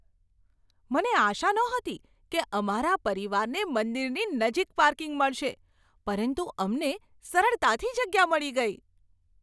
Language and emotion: Gujarati, surprised